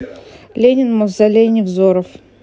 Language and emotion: Russian, neutral